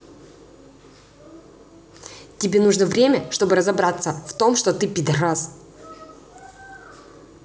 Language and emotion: Russian, angry